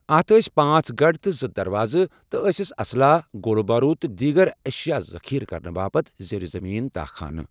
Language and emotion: Kashmiri, neutral